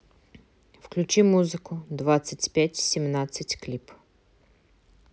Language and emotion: Russian, neutral